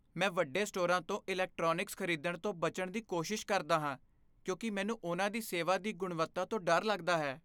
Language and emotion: Punjabi, fearful